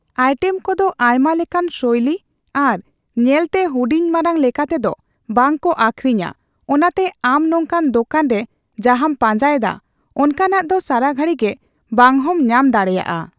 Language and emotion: Santali, neutral